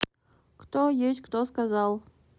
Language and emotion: Russian, neutral